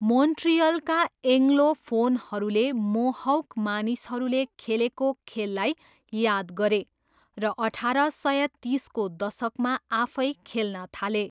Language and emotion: Nepali, neutral